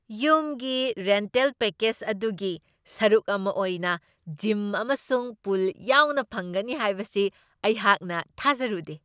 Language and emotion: Manipuri, surprised